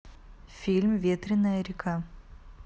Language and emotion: Russian, neutral